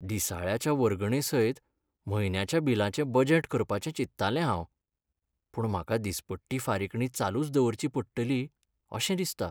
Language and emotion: Goan Konkani, sad